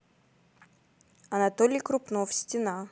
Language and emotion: Russian, neutral